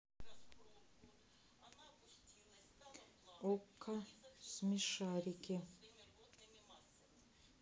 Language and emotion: Russian, neutral